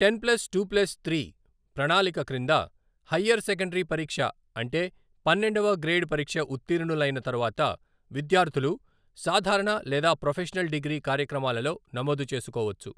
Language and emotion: Telugu, neutral